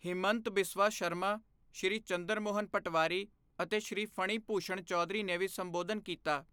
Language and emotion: Punjabi, neutral